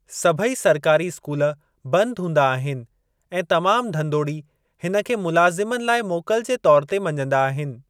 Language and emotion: Sindhi, neutral